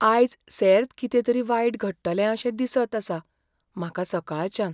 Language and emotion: Goan Konkani, fearful